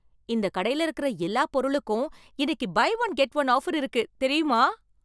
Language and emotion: Tamil, surprised